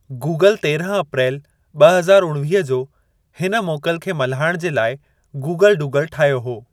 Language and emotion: Sindhi, neutral